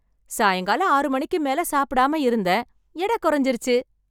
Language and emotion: Tamil, happy